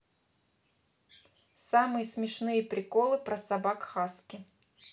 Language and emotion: Russian, neutral